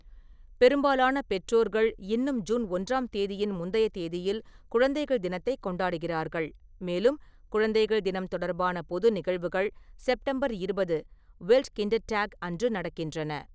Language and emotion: Tamil, neutral